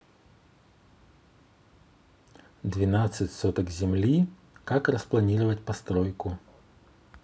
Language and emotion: Russian, neutral